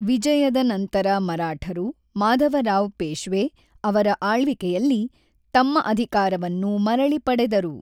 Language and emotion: Kannada, neutral